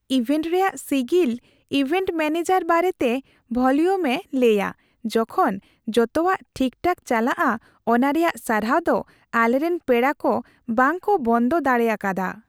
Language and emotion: Santali, happy